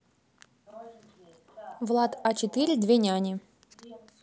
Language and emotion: Russian, neutral